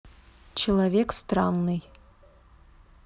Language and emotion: Russian, neutral